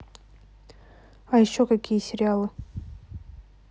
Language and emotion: Russian, neutral